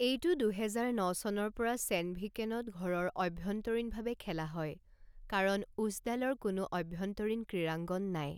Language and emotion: Assamese, neutral